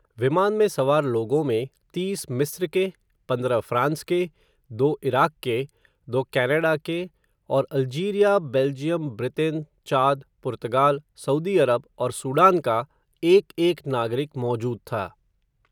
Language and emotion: Hindi, neutral